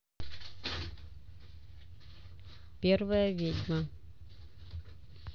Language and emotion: Russian, neutral